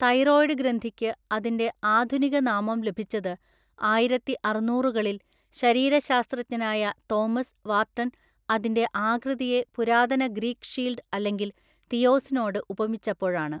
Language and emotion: Malayalam, neutral